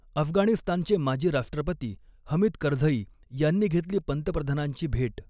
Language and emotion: Marathi, neutral